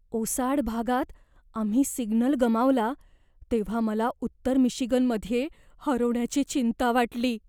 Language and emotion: Marathi, fearful